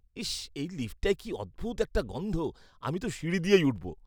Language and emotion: Bengali, disgusted